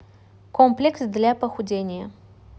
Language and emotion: Russian, neutral